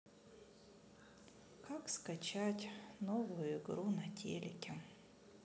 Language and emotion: Russian, sad